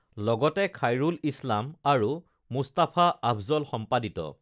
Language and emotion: Assamese, neutral